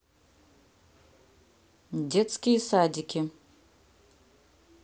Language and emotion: Russian, neutral